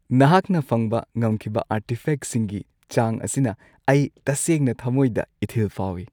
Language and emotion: Manipuri, happy